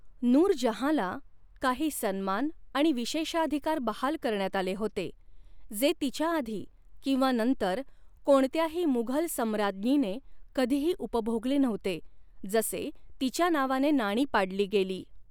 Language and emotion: Marathi, neutral